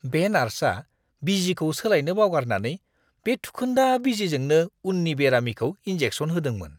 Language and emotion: Bodo, disgusted